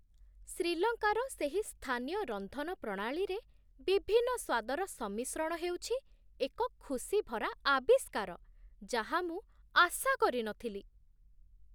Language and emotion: Odia, surprised